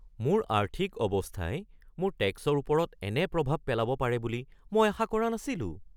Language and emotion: Assamese, surprised